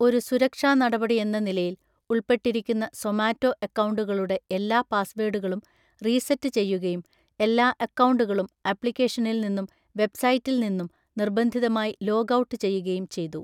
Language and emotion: Malayalam, neutral